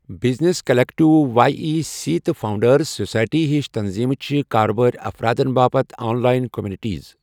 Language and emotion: Kashmiri, neutral